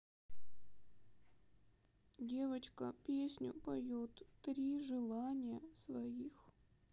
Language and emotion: Russian, sad